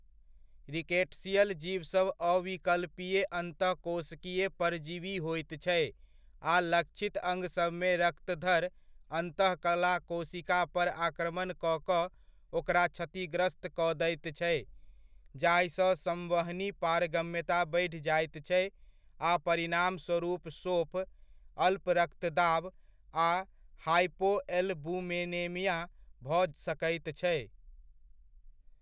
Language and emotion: Maithili, neutral